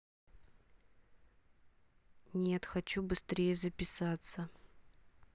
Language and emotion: Russian, neutral